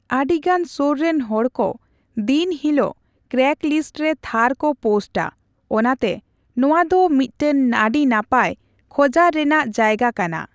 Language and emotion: Santali, neutral